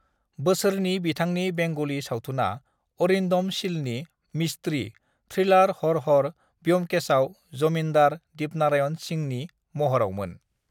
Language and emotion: Bodo, neutral